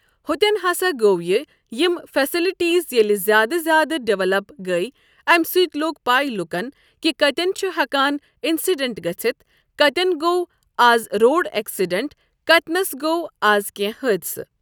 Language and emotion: Kashmiri, neutral